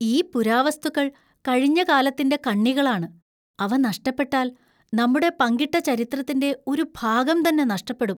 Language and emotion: Malayalam, fearful